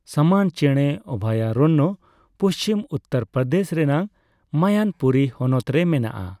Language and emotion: Santali, neutral